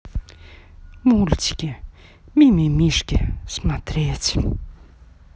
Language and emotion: Russian, positive